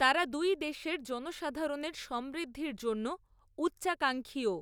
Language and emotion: Bengali, neutral